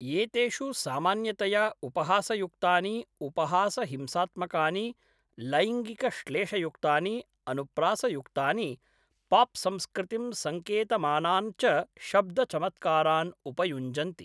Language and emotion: Sanskrit, neutral